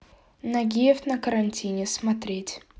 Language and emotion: Russian, neutral